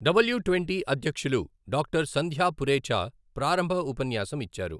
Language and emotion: Telugu, neutral